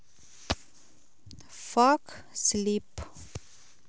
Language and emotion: Russian, neutral